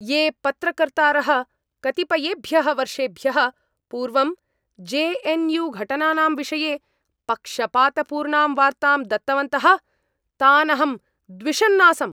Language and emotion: Sanskrit, angry